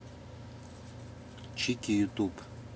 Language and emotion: Russian, neutral